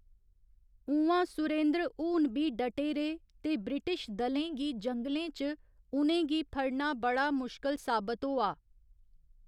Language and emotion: Dogri, neutral